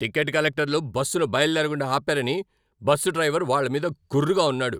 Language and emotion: Telugu, angry